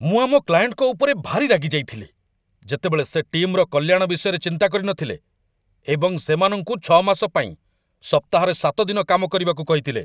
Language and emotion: Odia, angry